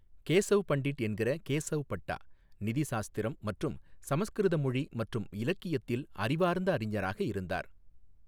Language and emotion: Tamil, neutral